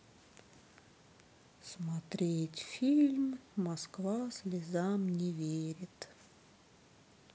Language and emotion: Russian, sad